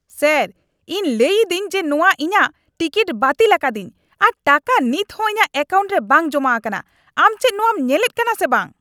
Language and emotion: Santali, angry